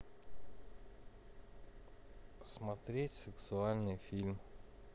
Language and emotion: Russian, neutral